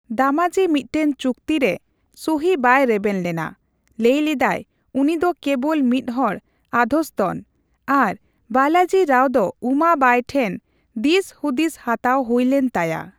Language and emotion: Santali, neutral